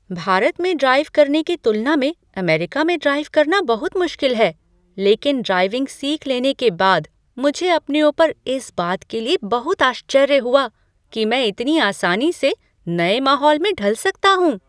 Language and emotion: Hindi, surprised